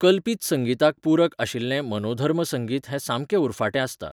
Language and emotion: Goan Konkani, neutral